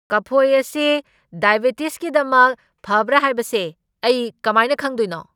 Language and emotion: Manipuri, angry